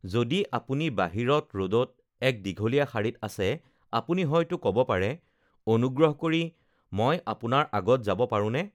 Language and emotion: Assamese, neutral